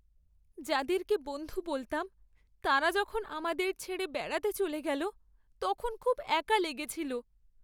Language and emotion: Bengali, sad